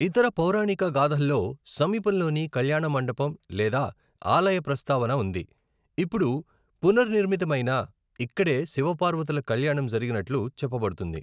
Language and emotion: Telugu, neutral